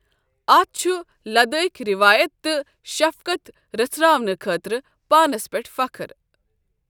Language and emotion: Kashmiri, neutral